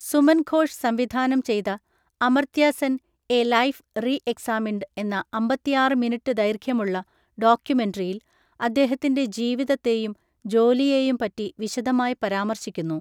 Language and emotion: Malayalam, neutral